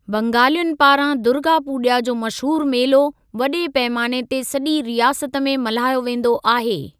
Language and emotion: Sindhi, neutral